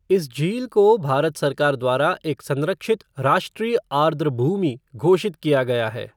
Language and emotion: Hindi, neutral